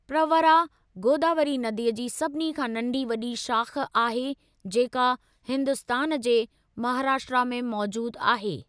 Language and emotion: Sindhi, neutral